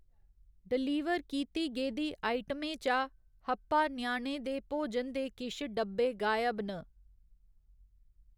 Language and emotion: Dogri, neutral